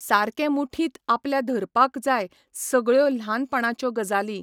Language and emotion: Goan Konkani, neutral